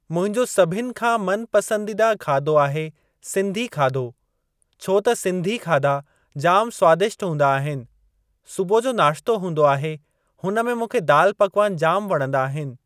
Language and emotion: Sindhi, neutral